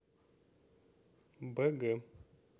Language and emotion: Russian, neutral